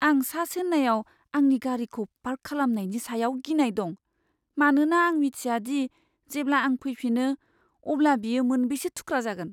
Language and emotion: Bodo, fearful